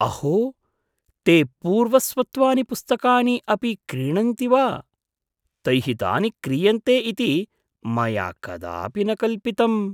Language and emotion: Sanskrit, surprised